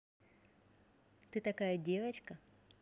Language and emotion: Russian, positive